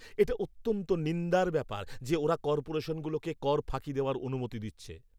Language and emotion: Bengali, angry